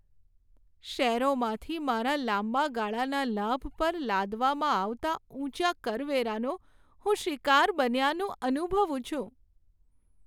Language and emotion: Gujarati, sad